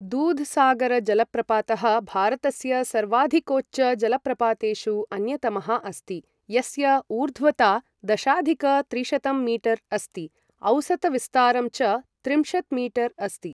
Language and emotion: Sanskrit, neutral